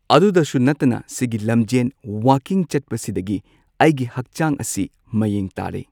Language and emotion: Manipuri, neutral